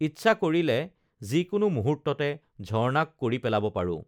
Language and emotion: Assamese, neutral